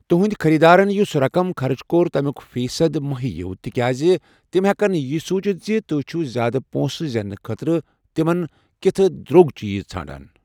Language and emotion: Kashmiri, neutral